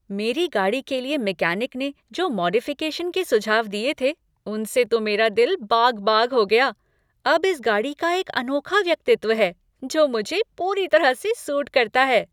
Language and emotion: Hindi, happy